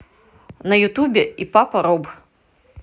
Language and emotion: Russian, positive